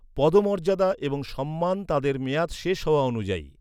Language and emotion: Bengali, neutral